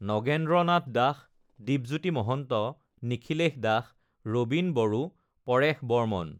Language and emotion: Assamese, neutral